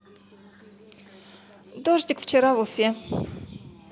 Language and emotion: Russian, positive